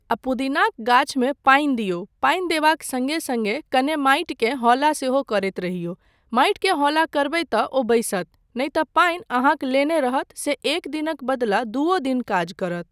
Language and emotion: Maithili, neutral